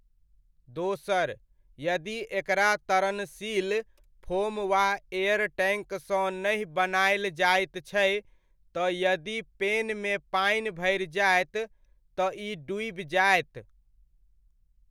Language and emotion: Maithili, neutral